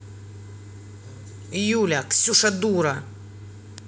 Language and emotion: Russian, angry